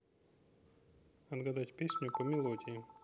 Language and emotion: Russian, neutral